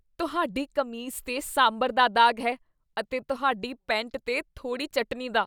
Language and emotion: Punjabi, disgusted